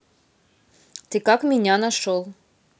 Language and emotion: Russian, neutral